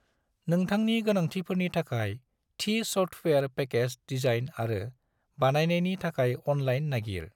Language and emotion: Bodo, neutral